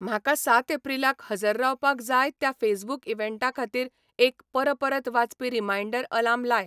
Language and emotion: Goan Konkani, neutral